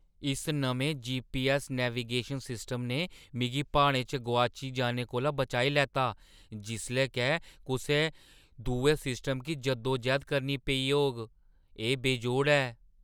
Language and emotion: Dogri, surprised